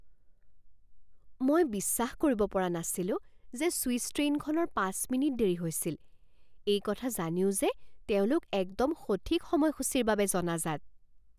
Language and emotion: Assamese, surprised